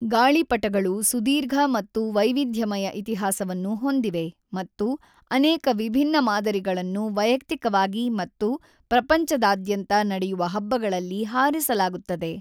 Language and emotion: Kannada, neutral